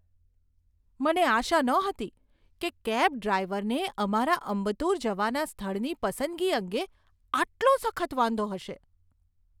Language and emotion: Gujarati, surprised